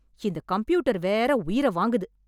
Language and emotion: Tamil, angry